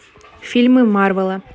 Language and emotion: Russian, neutral